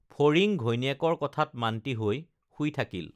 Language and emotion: Assamese, neutral